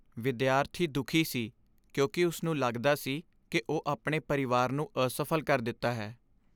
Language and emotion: Punjabi, sad